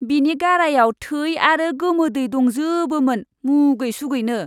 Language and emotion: Bodo, disgusted